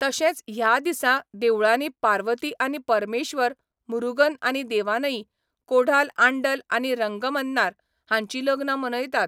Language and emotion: Goan Konkani, neutral